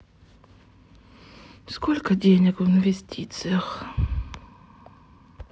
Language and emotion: Russian, sad